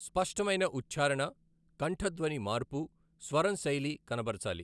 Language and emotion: Telugu, neutral